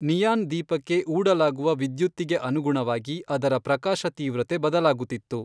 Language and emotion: Kannada, neutral